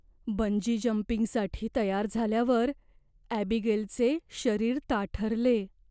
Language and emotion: Marathi, fearful